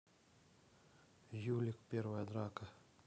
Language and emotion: Russian, neutral